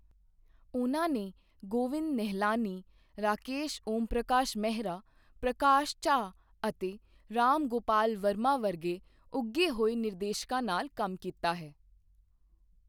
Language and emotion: Punjabi, neutral